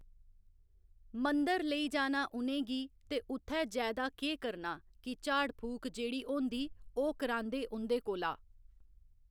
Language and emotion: Dogri, neutral